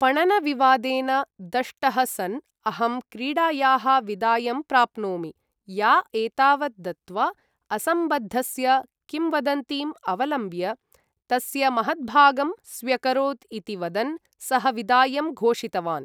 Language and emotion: Sanskrit, neutral